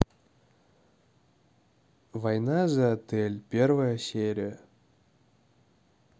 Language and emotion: Russian, neutral